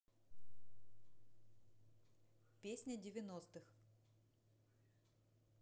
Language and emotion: Russian, neutral